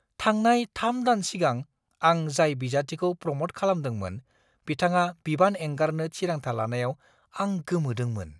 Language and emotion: Bodo, surprised